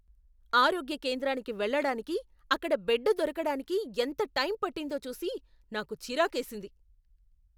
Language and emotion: Telugu, angry